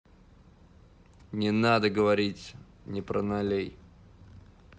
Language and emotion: Russian, angry